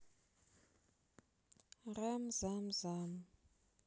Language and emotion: Russian, sad